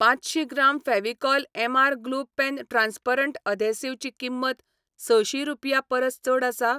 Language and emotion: Goan Konkani, neutral